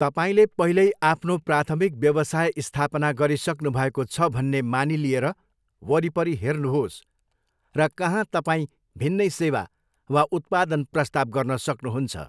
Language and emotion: Nepali, neutral